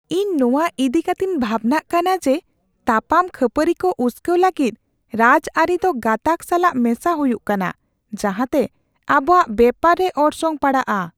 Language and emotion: Santali, fearful